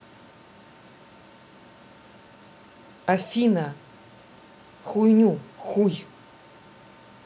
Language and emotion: Russian, neutral